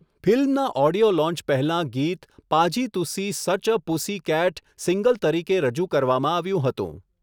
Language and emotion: Gujarati, neutral